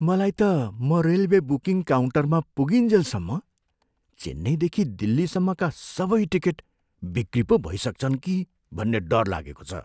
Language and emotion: Nepali, fearful